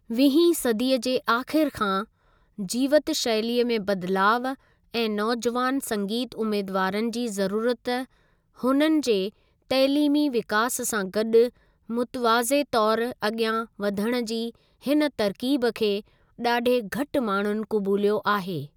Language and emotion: Sindhi, neutral